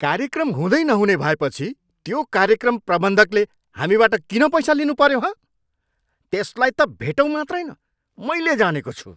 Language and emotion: Nepali, angry